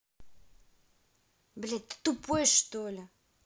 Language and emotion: Russian, angry